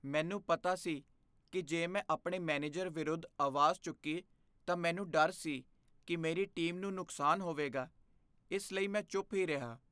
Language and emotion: Punjabi, fearful